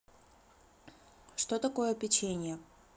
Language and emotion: Russian, neutral